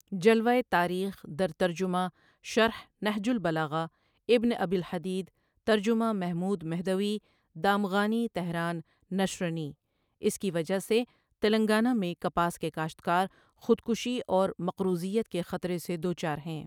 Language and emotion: Urdu, neutral